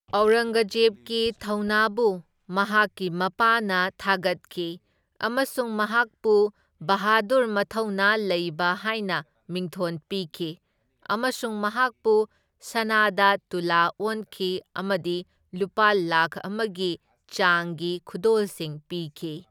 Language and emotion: Manipuri, neutral